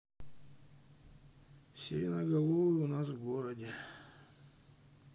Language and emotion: Russian, sad